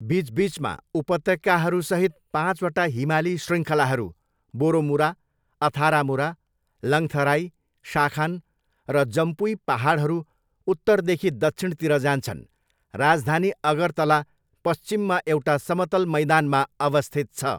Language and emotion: Nepali, neutral